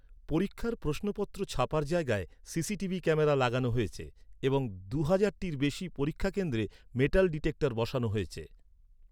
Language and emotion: Bengali, neutral